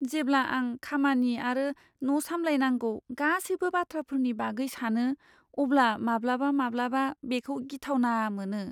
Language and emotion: Bodo, fearful